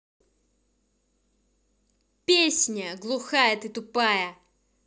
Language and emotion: Russian, angry